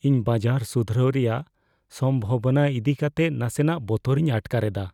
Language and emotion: Santali, fearful